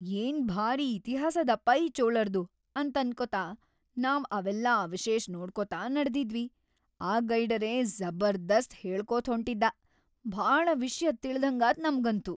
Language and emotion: Kannada, happy